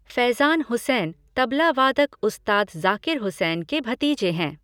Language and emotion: Hindi, neutral